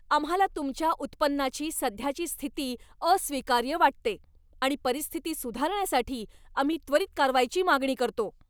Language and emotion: Marathi, angry